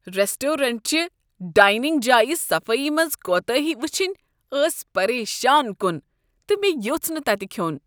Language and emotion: Kashmiri, disgusted